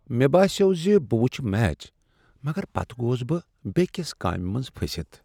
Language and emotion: Kashmiri, sad